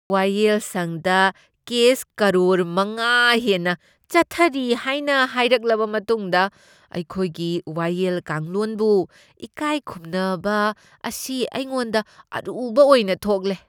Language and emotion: Manipuri, disgusted